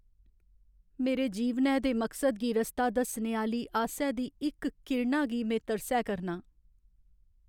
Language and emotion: Dogri, sad